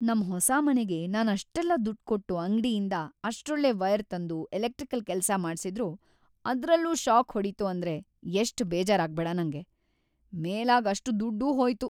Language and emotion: Kannada, sad